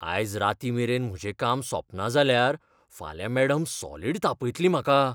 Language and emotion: Goan Konkani, fearful